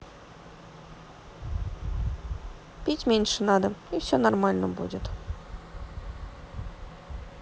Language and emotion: Russian, neutral